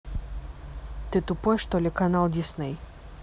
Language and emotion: Russian, angry